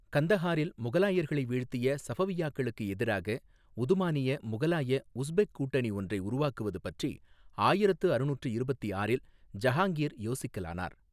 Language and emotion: Tamil, neutral